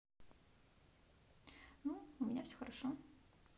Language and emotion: Russian, neutral